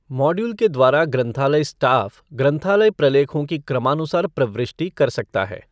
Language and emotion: Hindi, neutral